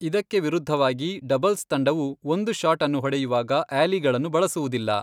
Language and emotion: Kannada, neutral